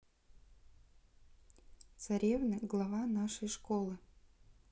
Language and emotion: Russian, neutral